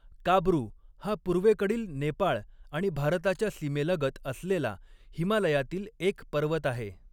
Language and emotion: Marathi, neutral